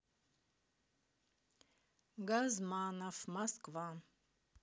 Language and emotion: Russian, neutral